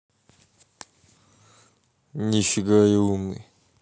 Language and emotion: Russian, neutral